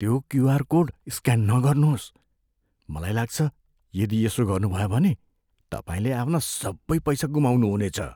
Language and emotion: Nepali, fearful